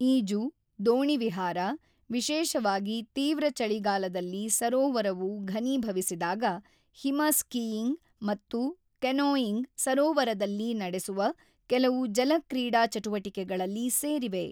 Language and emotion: Kannada, neutral